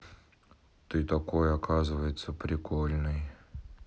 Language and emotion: Russian, neutral